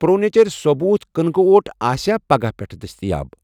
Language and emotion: Kashmiri, neutral